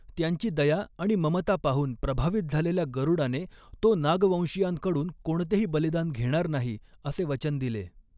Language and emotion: Marathi, neutral